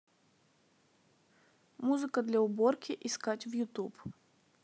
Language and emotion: Russian, neutral